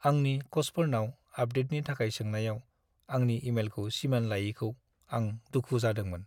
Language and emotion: Bodo, sad